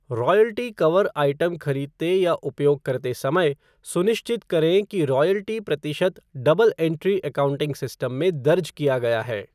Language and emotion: Hindi, neutral